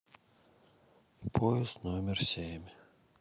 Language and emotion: Russian, sad